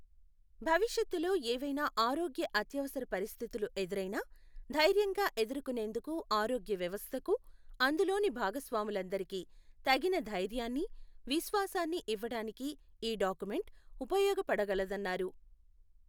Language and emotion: Telugu, neutral